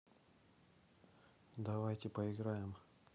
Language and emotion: Russian, neutral